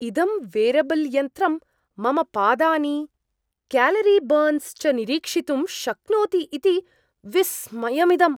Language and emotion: Sanskrit, surprised